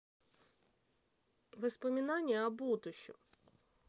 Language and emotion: Russian, neutral